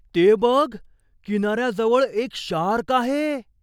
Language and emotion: Marathi, surprised